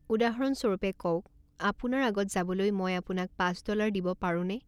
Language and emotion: Assamese, neutral